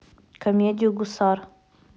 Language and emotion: Russian, neutral